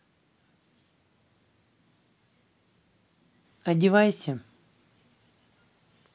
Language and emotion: Russian, neutral